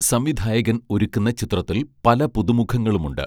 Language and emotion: Malayalam, neutral